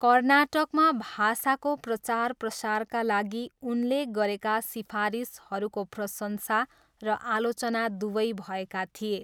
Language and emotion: Nepali, neutral